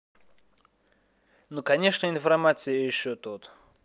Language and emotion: Russian, neutral